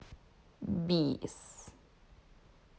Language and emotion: Russian, neutral